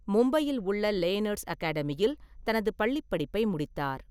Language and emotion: Tamil, neutral